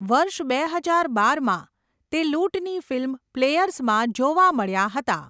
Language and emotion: Gujarati, neutral